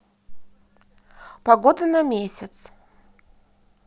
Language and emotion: Russian, positive